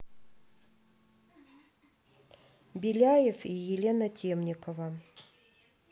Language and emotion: Russian, neutral